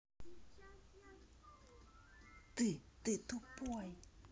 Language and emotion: Russian, angry